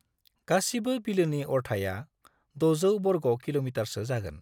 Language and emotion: Bodo, neutral